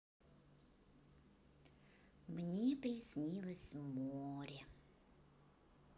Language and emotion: Russian, positive